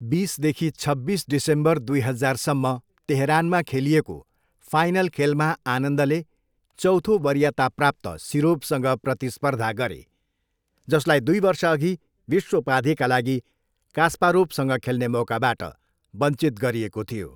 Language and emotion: Nepali, neutral